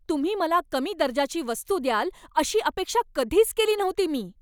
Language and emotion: Marathi, angry